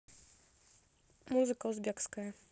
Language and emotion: Russian, neutral